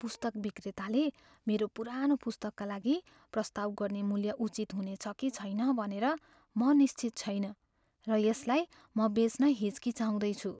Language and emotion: Nepali, fearful